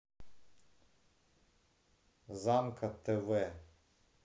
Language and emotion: Russian, neutral